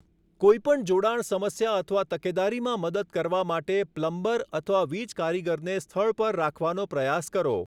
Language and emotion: Gujarati, neutral